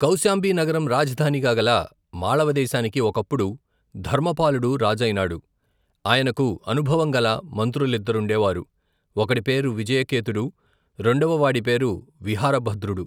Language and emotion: Telugu, neutral